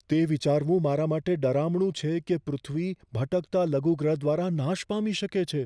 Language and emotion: Gujarati, fearful